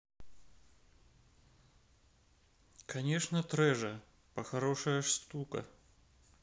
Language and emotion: Russian, neutral